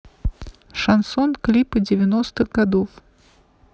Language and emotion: Russian, neutral